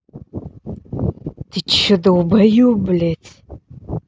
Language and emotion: Russian, angry